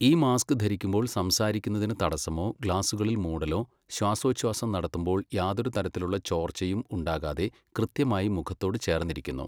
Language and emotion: Malayalam, neutral